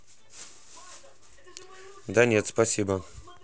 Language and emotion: Russian, neutral